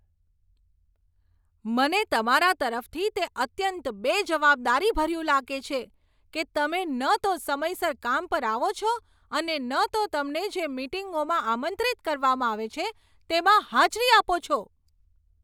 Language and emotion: Gujarati, angry